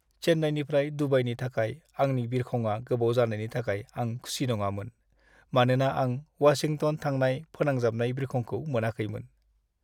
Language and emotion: Bodo, sad